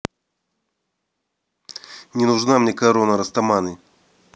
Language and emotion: Russian, angry